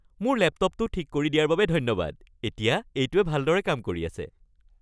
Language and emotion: Assamese, happy